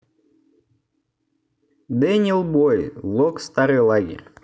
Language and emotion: Russian, neutral